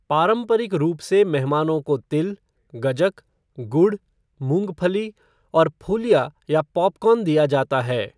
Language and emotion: Hindi, neutral